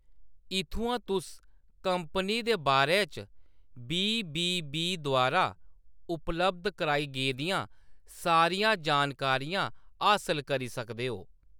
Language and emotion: Dogri, neutral